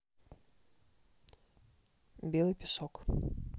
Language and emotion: Russian, neutral